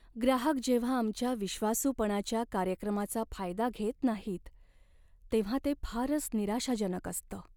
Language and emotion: Marathi, sad